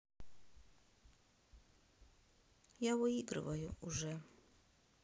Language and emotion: Russian, sad